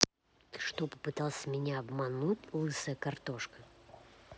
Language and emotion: Russian, angry